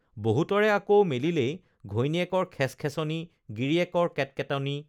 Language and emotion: Assamese, neutral